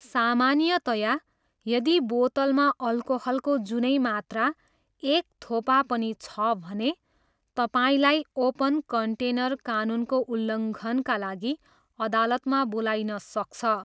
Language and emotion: Nepali, neutral